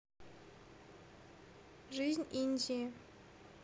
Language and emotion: Russian, neutral